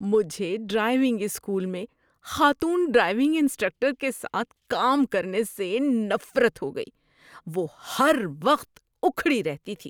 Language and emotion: Urdu, disgusted